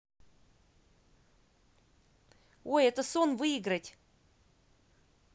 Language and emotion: Russian, positive